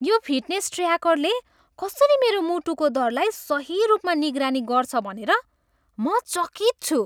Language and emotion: Nepali, surprised